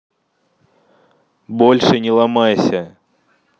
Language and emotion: Russian, angry